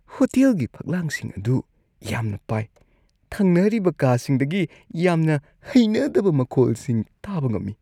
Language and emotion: Manipuri, disgusted